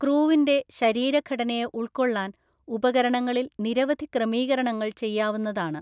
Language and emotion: Malayalam, neutral